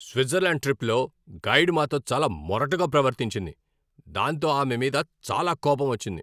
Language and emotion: Telugu, angry